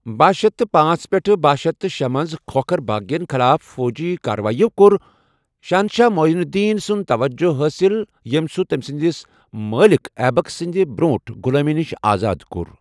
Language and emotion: Kashmiri, neutral